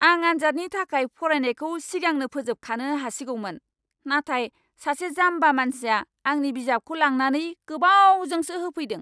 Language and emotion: Bodo, angry